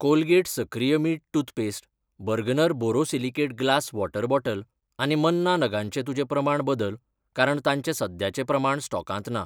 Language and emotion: Goan Konkani, neutral